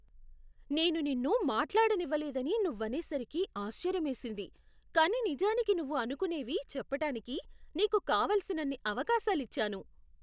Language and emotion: Telugu, surprised